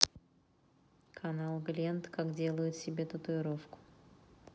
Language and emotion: Russian, neutral